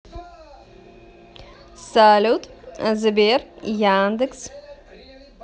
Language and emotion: Russian, positive